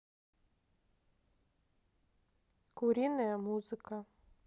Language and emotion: Russian, neutral